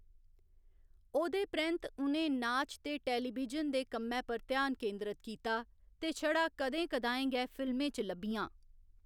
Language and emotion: Dogri, neutral